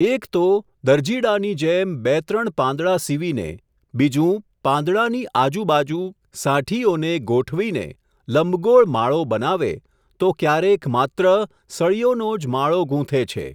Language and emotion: Gujarati, neutral